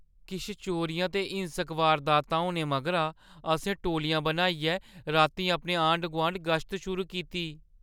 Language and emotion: Dogri, fearful